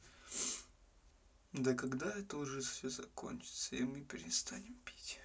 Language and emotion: Russian, sad